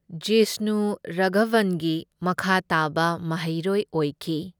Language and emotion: Manipuri, neutral